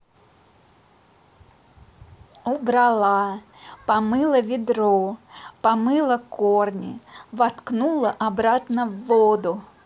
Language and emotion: Russian, positive